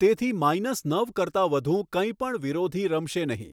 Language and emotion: Gujarati, neutral